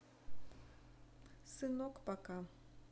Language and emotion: Russian, neutral